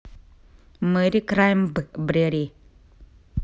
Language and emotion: Russian, neutral